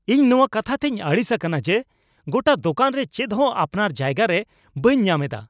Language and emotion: Santali, angry